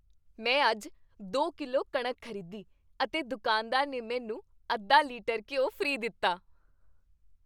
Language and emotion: Punjabi, happy